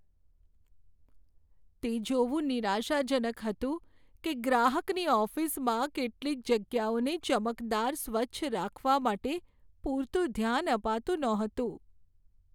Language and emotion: Gujarati, sad